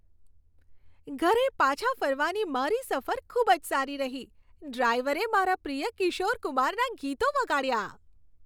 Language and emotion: Gujarati, happy